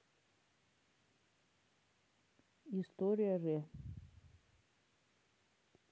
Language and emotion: Russian, neutral